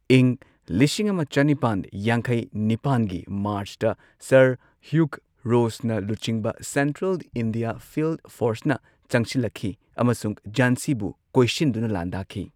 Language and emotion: Manipuri, neutral